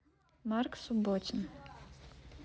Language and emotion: Russian, neutral